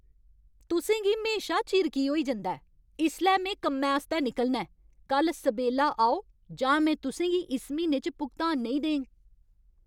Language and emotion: Dogri, angry